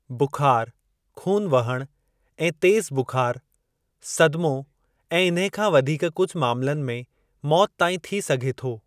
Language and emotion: Sindhi, neutral